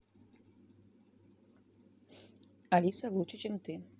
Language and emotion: Russian, neutral